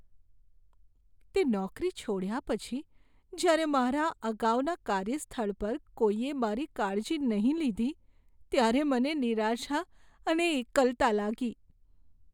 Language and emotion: Gujarati, sad